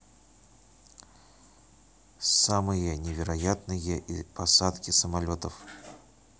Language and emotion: Russian, neutral